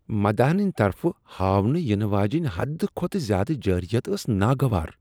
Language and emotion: Kashmiri, disgusted